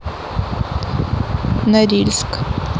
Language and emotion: Russian, neutral